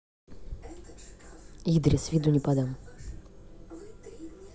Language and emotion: Russian, neutral